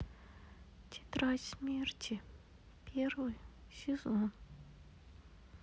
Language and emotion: Russian, sad